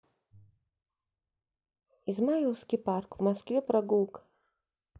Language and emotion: Russian, neutral